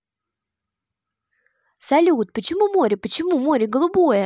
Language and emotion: Russian, positive